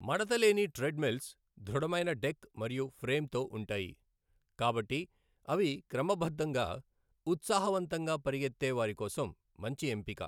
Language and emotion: Telugu, neutral